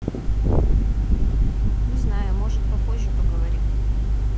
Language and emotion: Russian, neutral